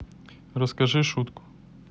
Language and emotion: Russian, neutral